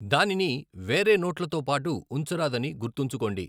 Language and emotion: Telugu, neutral